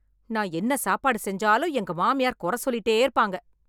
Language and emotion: Tamil, angry